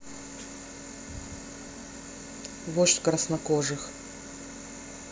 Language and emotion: Russian, neutral